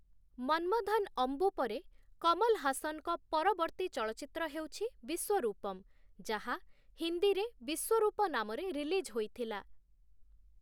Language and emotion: Odia, neutral